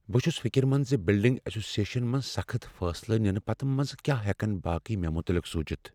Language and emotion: Kashmiri, fearful